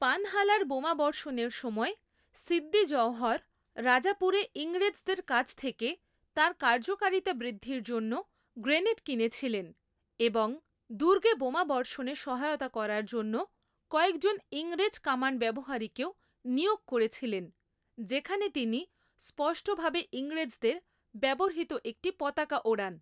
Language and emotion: Bengali, neutral